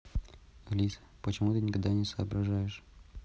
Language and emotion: Russian, neutral